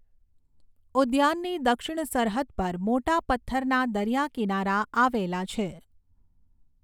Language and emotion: Gujarati, neutral